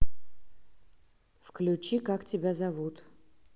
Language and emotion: Russian, neutral